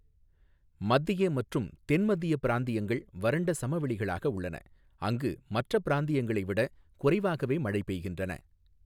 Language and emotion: Tamil, neutral